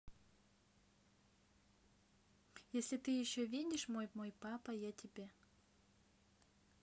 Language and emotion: Russian, neutral